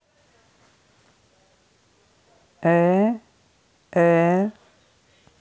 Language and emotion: Russian, neutral